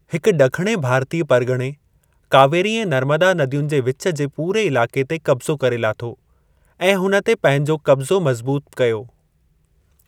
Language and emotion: Sindhi, neutral